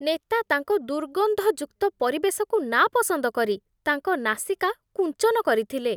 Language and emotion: Odia, disgusted